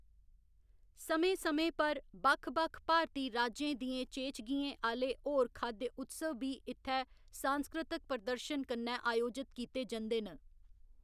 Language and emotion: Dogri, neutral